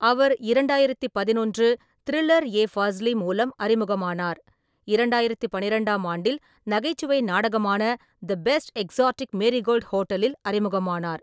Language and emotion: Tamil, neutral